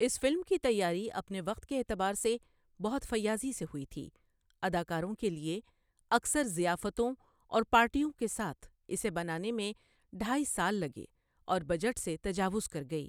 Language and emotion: Urdu, neutral